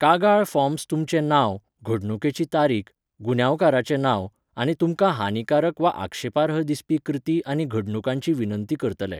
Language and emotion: Goan Konkani, neutral